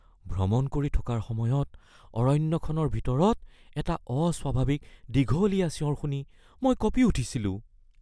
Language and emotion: Assamese, fearful